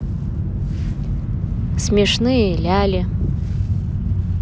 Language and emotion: Russian, neutral